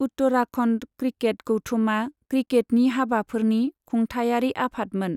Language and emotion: Bodo, neutral